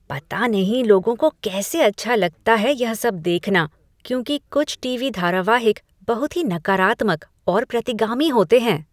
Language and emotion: Hindi, disgusted